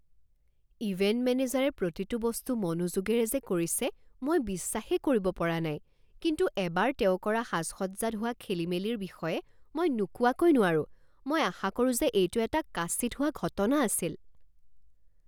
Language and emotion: Assamese, surprised